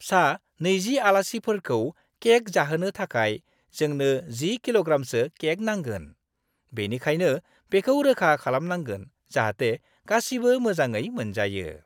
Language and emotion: Bodo, happy